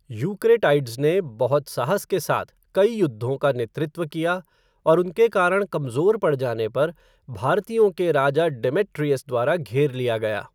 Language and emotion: Hindi, neutral